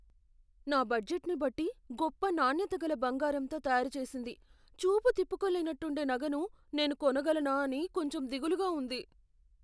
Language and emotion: Telugu, fearful